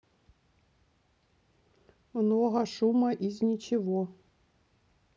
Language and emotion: Russian, neutral